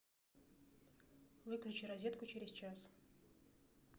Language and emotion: Russian, neutral